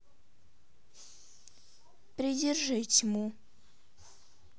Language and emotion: Russian, neutral